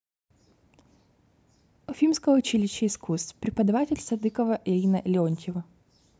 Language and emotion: Russian, neutral